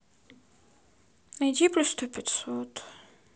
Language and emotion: Russian, sad